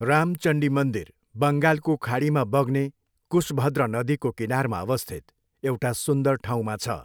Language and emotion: Nepali, neutral